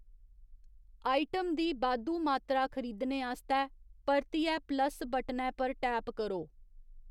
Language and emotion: Dogri, neutral